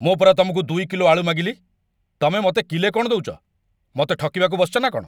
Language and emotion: Odia, angry